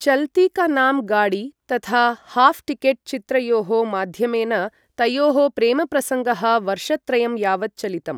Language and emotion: Sanskrit, neutral